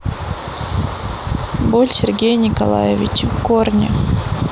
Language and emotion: Russian, neutral